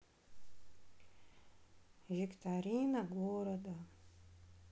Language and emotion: Russian, sad